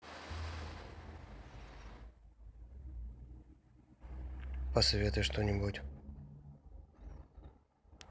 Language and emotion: Russian, neutral